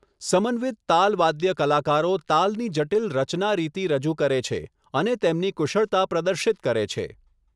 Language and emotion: Gujarati, neutral